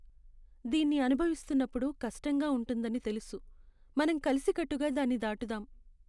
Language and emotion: Telugu, sad